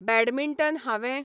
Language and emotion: Goan Konkani, neutral